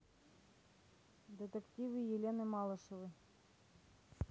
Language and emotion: Russian, neutral